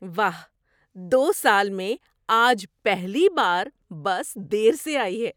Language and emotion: Urdu, surprised